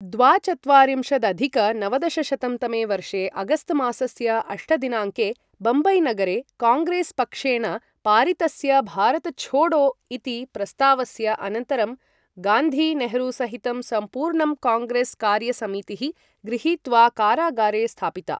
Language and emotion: Sanskrit, neutral